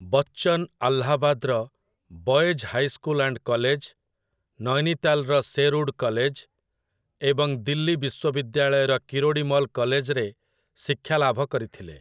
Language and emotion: Odia, neutral